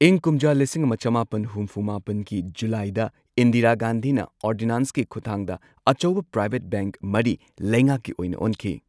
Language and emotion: Manipuri, neutral